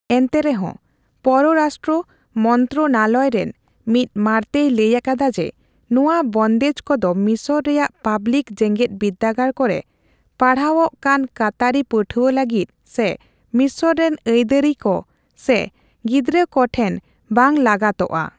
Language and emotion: Santali, neutral